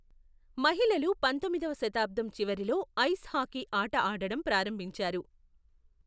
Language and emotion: Telugu, neutral